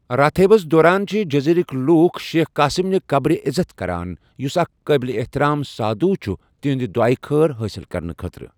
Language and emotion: Kashmiri, neutral